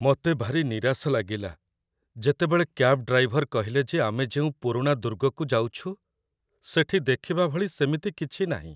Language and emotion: Odia, sad